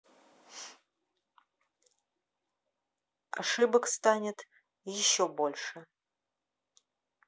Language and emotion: Russian, neutral